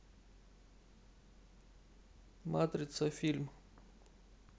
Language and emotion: Russian, neutral